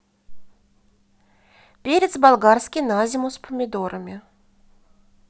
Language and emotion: Russian, positive